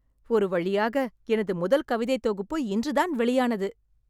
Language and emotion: Tamil, happy